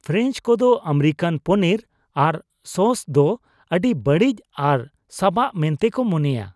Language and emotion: Santali, disgusted